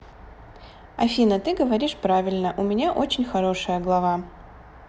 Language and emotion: Russian, positive